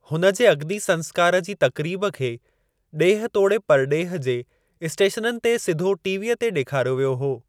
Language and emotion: Sindhi, neutral